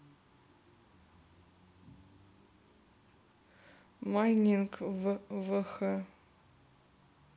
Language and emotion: Russian, neutral